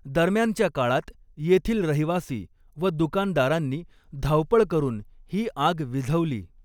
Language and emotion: Marathi, neutral